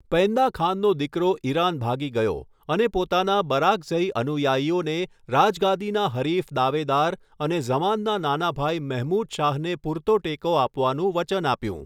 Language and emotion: Gujarati, neutral